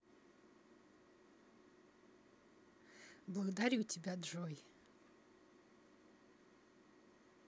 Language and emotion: Russian, positive